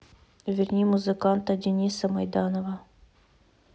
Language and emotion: Russian, neutral